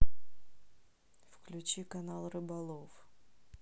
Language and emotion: Russian, neutral